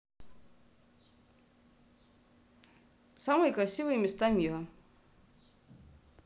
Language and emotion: Russian, neutral